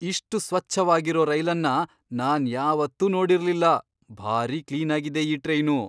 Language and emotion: Kannada, surprised